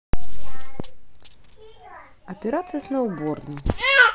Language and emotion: Russian, positive